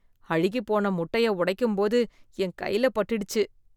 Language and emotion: Tamil, disgusted